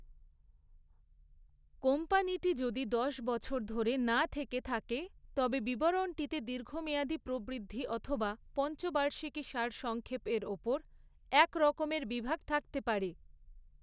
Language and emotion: Bengali, neutral